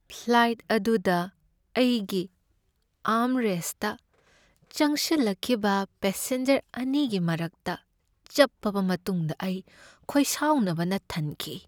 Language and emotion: Manipuri, sad